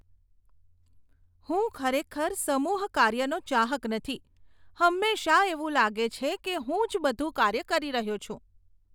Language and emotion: Gujarati, disgusted